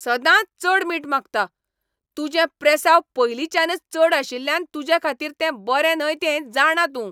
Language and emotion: Goan Konkani, angry